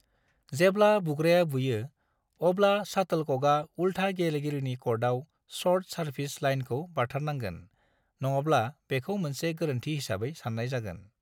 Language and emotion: Bodo, neutral